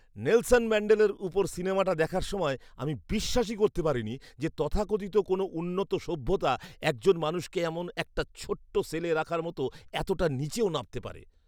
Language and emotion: Bengali, disgusted